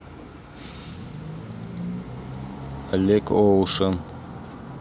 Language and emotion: Russian, neutral